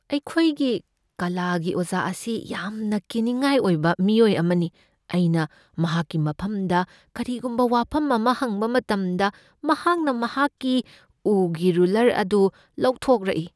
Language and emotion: Manipuri, fearful